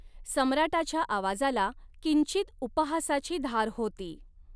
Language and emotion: Marathi, neutral